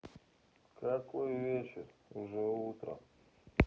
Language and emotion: Russian, neutral